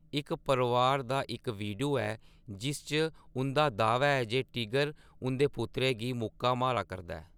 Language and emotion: Dogri, neutral